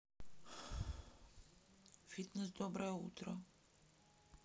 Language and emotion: Russian, sad